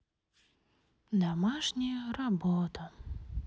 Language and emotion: Russian, sad